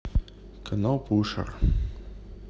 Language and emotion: Russian, neutral